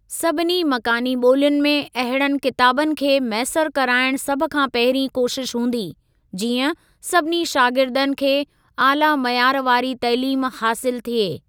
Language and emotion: Sindhi, neutral